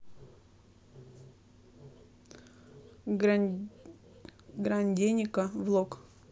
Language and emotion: Russian, neutral